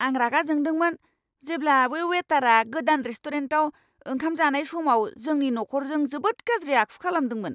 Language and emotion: Bodo, angry